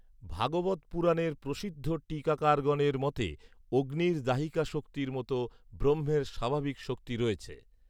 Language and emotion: Bengali, neutral